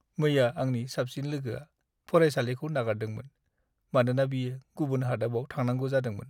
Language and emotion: Bodo, sad